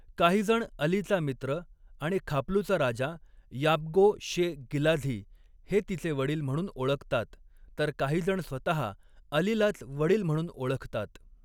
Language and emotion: Marathi, neutral